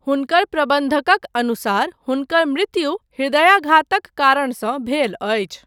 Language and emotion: Maithili, neutral